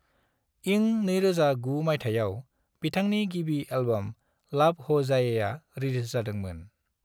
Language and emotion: Bodo, neutral